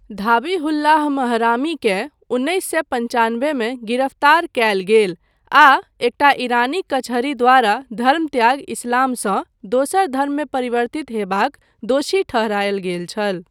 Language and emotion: Maithili, neutral